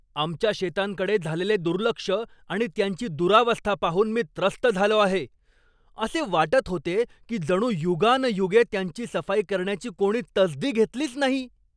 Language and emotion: Marathi, angry